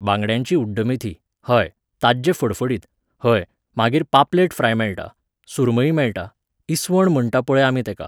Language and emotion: Goan Konkani, neutral